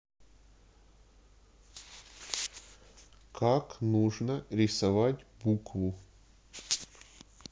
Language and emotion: Russian, neutral